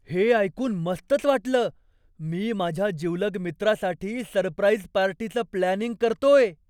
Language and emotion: Marathi, surprised